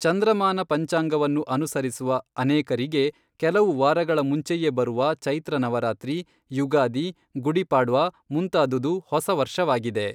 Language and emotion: Kannada, neutral